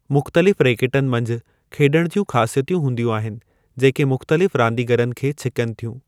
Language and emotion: Sindhi, neutral